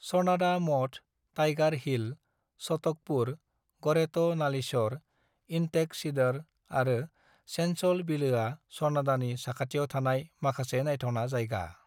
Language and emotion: Bodo, neutral